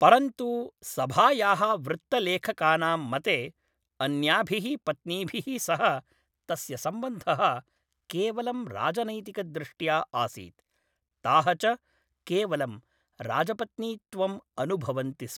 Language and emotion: Sanskrit, neutral